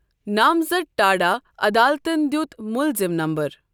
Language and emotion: Kashmiri, neutral